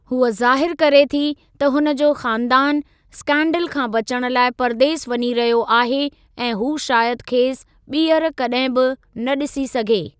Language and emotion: Sindhi, neutral